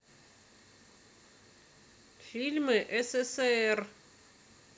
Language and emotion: Russian, neutral